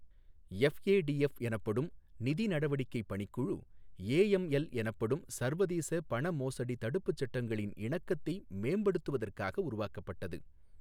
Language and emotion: Tamil, neutral